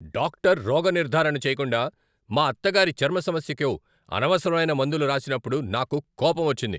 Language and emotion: Telugu, angry